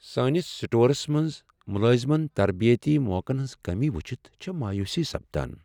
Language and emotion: Kashmiri, sad